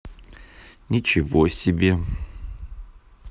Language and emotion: Russian, neutral